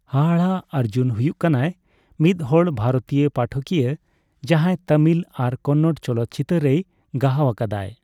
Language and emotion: Santali, neutral